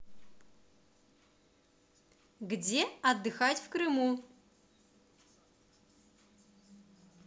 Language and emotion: Russian, positive